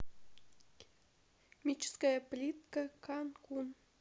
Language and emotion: Russian, neutral